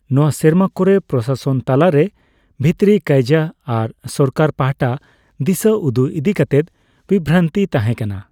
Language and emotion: Santali, neutral